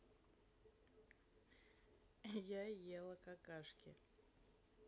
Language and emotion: Russian, neutral